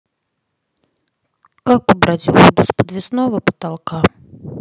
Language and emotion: Russian, neutral